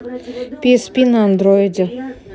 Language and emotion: Russian, neutral